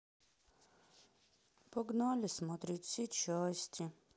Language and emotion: Russian, sad